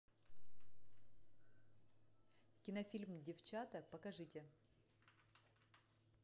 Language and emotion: Russian, neutral